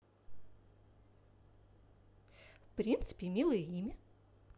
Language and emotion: Russian, positive